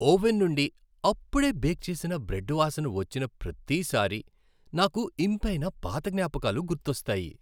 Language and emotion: Telugu, happy